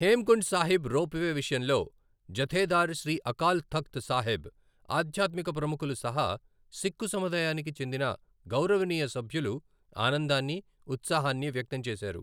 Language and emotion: Telugu, neutral